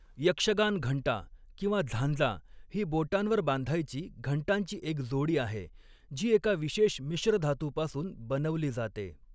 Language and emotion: Marathi, neutral